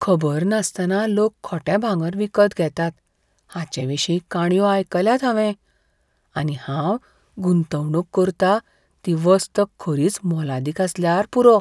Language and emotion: Goan Konkani, fearful